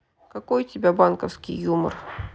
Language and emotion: Russian, neutral